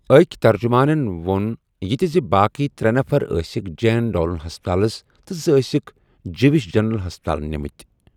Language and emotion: Kashmiri, neutral